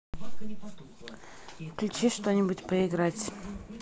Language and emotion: Russian, neutral